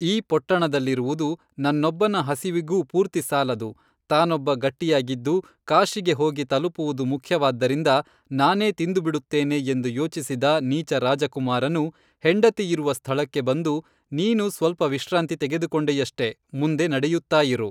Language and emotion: Kannada, neutral